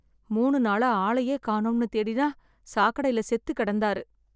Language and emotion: Tamil, sad